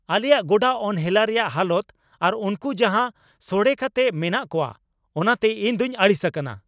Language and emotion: Santali, angry